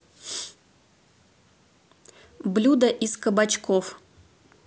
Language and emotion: Russian, neutral